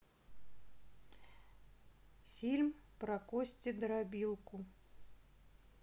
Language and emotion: Russian, neutral